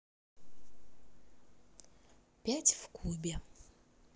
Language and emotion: Russian, positive